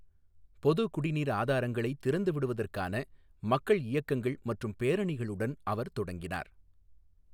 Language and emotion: Tamil, neutral